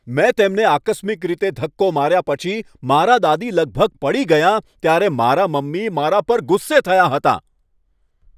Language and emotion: Gujarati, angry